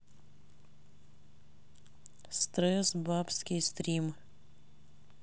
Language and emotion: Russian, neutral